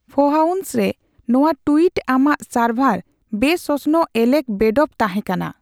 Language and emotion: Santali, neutral